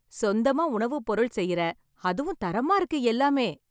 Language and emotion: Tamil, happy